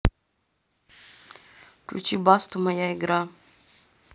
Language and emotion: Russian, neutral